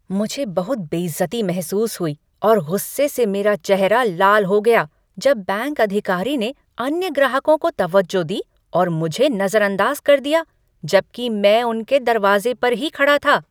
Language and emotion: Hindi, angry